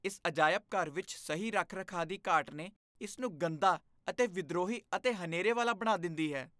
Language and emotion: Punjabi, disgusted